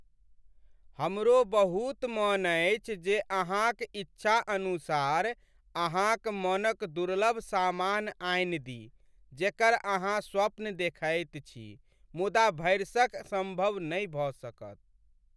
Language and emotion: Maithili, sad